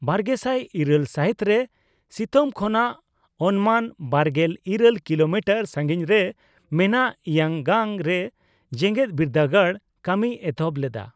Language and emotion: Santali, neutral